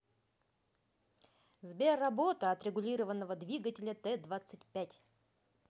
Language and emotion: Russian, positive